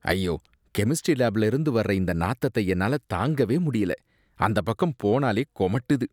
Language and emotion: Tamil, disgusted